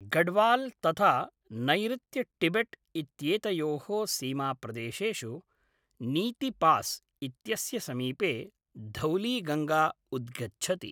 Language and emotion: Sanskrit, neutral